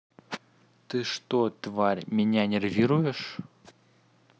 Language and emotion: Russian, neutral